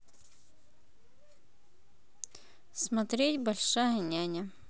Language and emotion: Russian, neutral